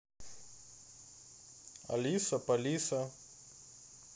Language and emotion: Russian, neutral